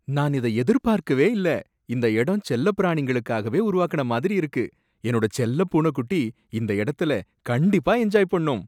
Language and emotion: Tamil, surprised